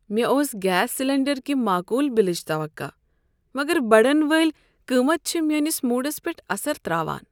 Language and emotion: Kashmiri, sad